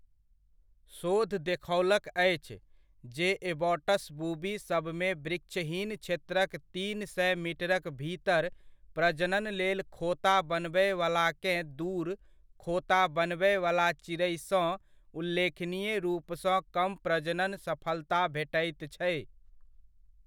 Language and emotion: Maithili, neutral